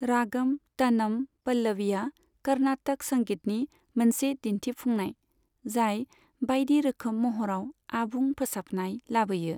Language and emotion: Bodo, neutral